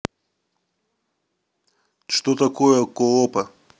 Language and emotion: Russian, neutral